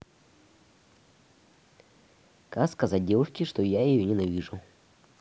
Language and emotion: Russian, neutral